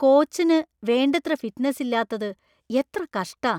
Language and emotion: Malayalam, disgusted